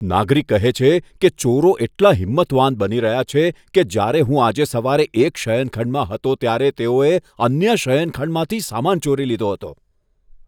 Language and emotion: Gujarati, disgusted